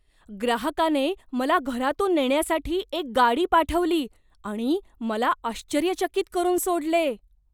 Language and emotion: Marathi, surprised